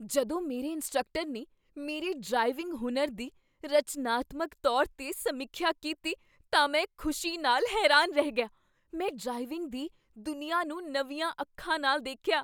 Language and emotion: Punjabi, surprised